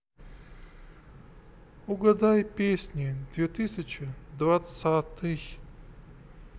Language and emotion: Russian, sad